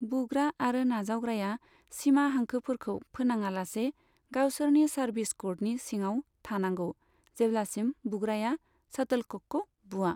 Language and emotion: Bodo, neutral